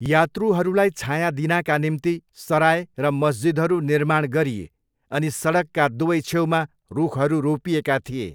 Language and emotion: Nepali, neutral